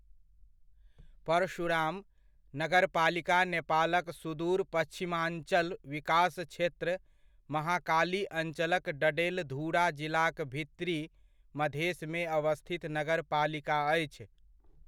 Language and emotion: Maithili, neutral